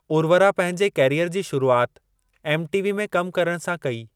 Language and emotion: Sindhi, neutral